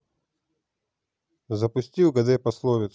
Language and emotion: Russian, neutral